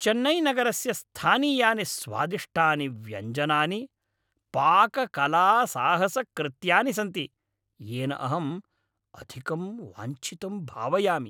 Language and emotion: Sanskrit, happy